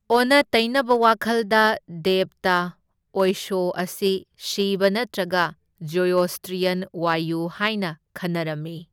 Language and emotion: Manipuri, neutral